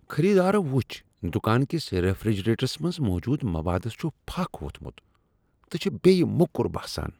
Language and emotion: Kashmiri, disgusted